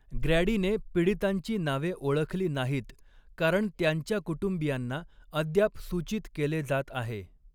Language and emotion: Marathi, neutral